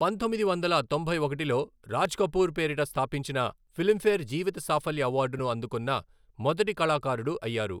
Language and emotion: Telugu, neutral